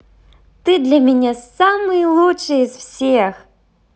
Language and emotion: Russian, positive